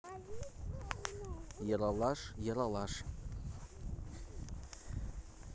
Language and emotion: Russian, neutral